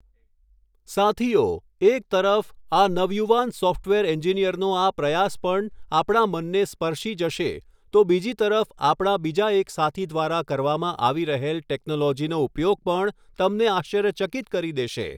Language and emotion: Gujarati, neutral